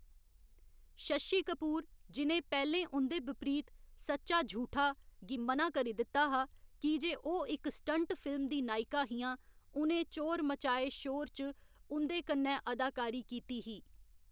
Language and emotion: Dogri, neutral